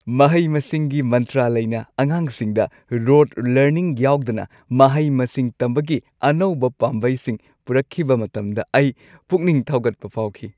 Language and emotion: Manipuri, happy